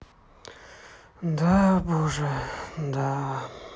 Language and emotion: Russian, sad